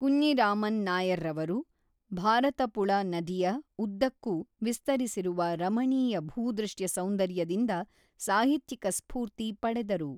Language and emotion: Kannada, neutral